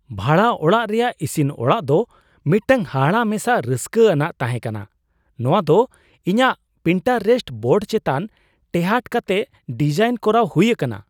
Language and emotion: Santali, surprised